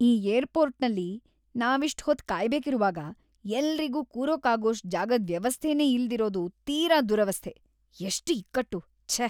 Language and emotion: Kannada, disgusted